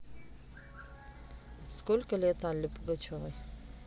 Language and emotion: Russian, neutral